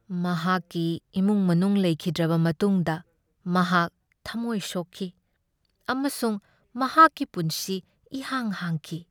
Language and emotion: Manipuri, sad